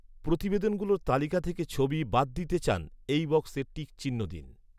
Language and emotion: Bengali, neutral